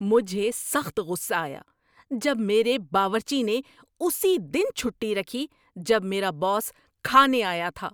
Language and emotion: Urdu, angry